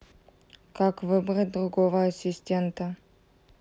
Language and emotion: Russian, neutral